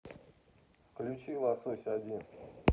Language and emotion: Russian, neutral